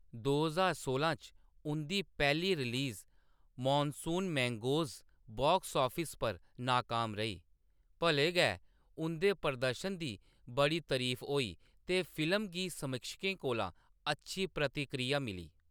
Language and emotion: Dogri, neutral